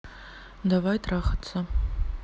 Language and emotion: Russian, neutral